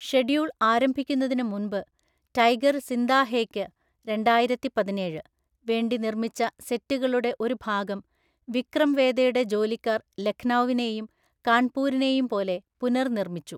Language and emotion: Malayalam, neutral